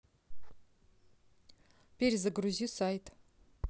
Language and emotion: Russian, neutral